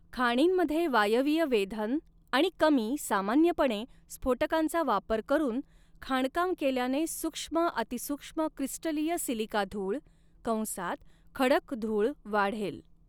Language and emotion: Marathi, neutral